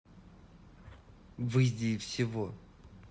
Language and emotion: Russian, angry